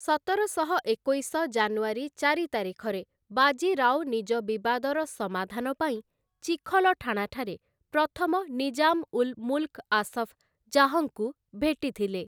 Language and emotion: Odia, neutral